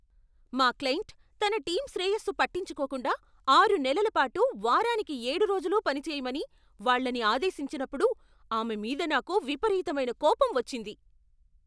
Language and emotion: Telugu, angry